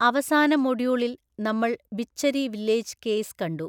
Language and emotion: Malayalam, neutral